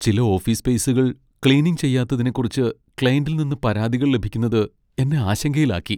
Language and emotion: Malayalam, sad